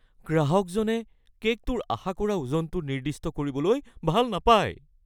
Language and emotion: Assamese, fearful